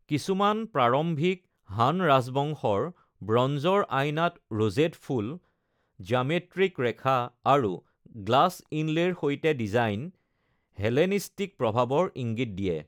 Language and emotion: Assamese, neutral